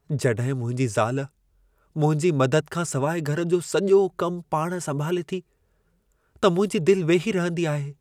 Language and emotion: Sindhi, sad